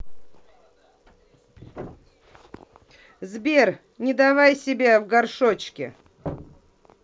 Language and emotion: Russian, angry